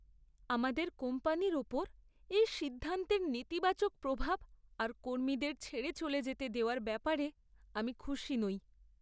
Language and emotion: Bengali, sad